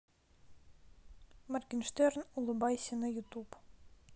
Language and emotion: Russian, neutral